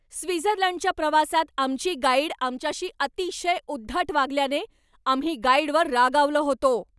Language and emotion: Marathi, angry